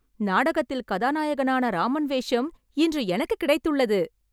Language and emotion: Tamil, happy